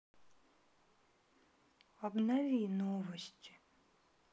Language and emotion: Russian, sad